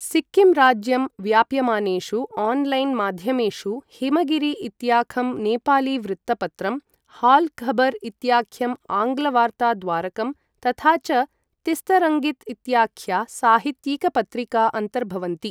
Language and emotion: Sanskrit, neutral